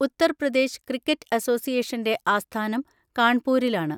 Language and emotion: Malayalam, neutral